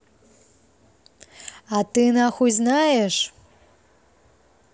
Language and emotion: Russian, angry